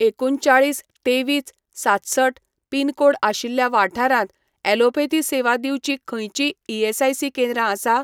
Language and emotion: Goan Konkani, neutral